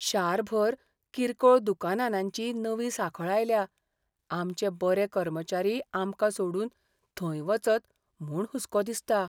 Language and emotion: Goan Konkani, fearful